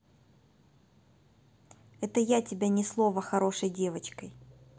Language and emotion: Russian, neutral